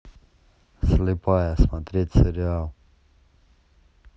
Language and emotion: Russian, neutral